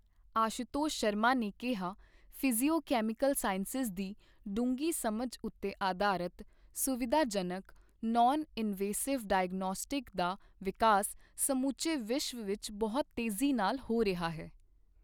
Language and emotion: Punjabi, neutral